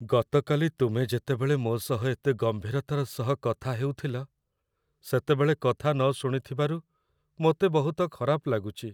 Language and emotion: Odia, sad